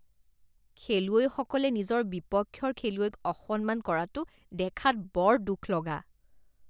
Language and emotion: Assamese, disgusted